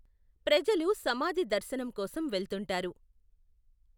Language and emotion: Telugu, neutral